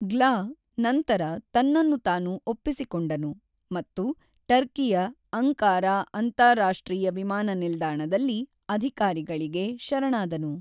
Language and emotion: Kannada, neutral